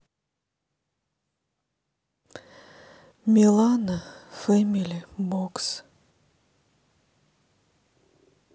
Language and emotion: Russian, sad